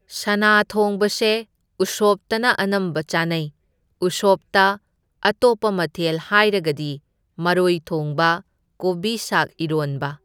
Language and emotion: Manipuri, neutral